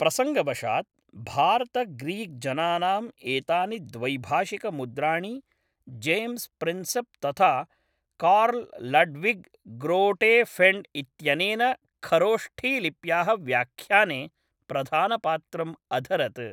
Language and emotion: Sanskrit, neutral